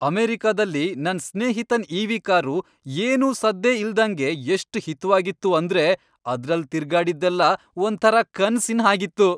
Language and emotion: Kannada, happy